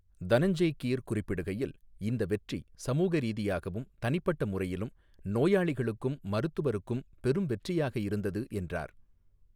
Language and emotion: Tamil, neutral